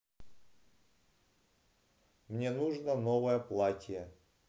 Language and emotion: Russian, neutral